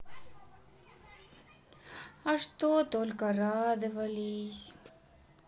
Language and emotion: Russian, sad